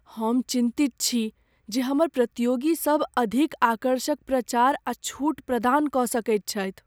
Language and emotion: Maithili, fearful